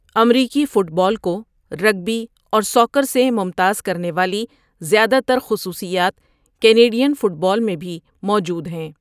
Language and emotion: Urdu, neutral